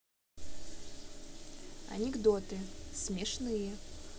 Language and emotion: Russian, neutral